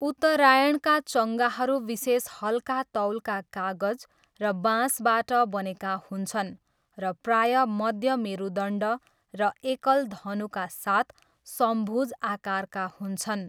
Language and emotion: Nepali, neutral